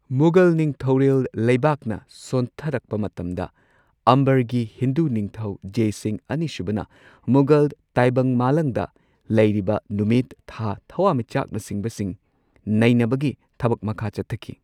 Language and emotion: Manipuri, neutral